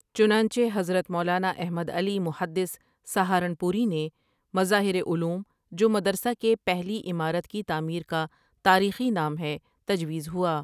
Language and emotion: Urdu, neutral